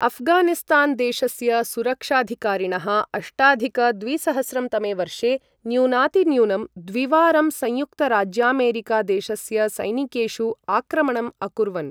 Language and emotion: Sanskrit, neutral